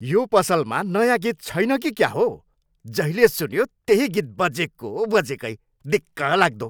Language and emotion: Nepali, angry